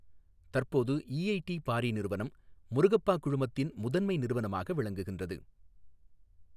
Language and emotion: Tamil, neutral